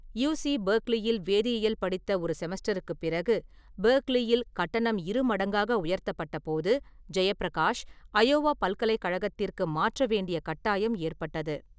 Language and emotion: Tamil, neutral